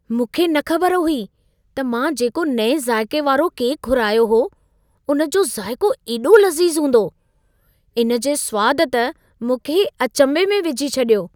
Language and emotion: Sindhi, surprised